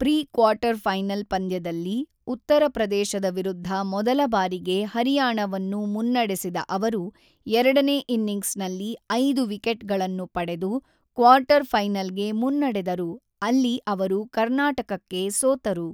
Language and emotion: Kannada, neutral